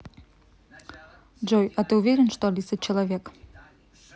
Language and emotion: Russian, neutral